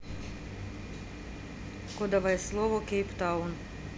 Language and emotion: Russian, neutral